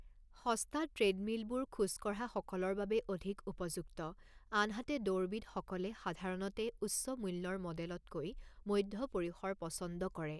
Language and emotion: Assamese, neutral